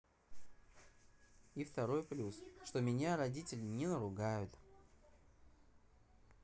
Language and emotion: Russian, neutral